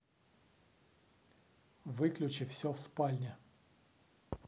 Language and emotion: Russian, angry